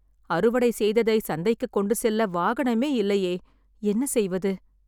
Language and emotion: Tamil, sad